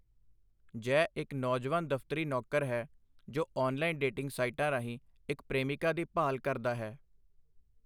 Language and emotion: Punjabi, neutral